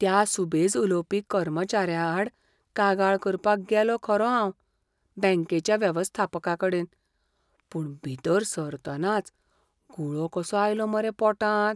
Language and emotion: Goan Konkani, fearful